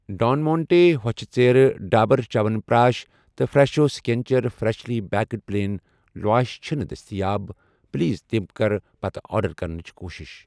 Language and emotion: Kashmiri, neutral